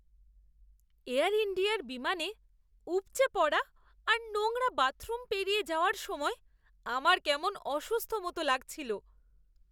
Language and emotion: Bengali, disgusted